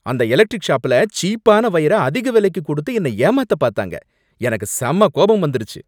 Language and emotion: Tamil, angry